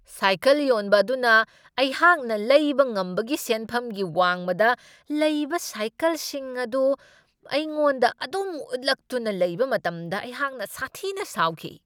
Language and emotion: Manipuri, angry